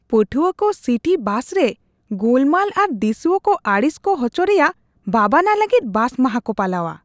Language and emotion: Santali, disgusted